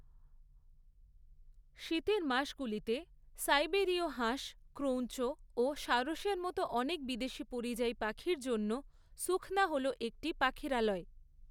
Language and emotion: Bengali, neutral